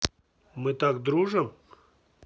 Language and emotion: Russian, neutral